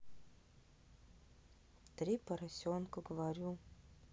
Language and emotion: Russian, neutral